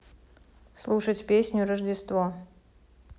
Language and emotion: Russian, neutral